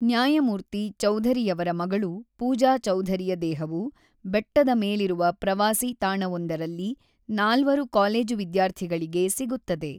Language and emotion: Kannada, neutral